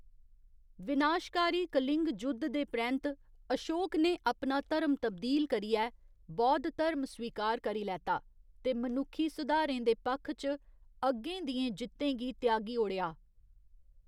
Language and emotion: Dogri, neutral